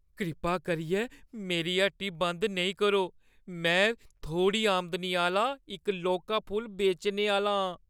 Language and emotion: Dogri, fearful